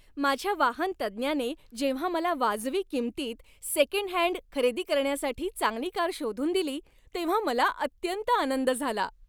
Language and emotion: Marathi, happy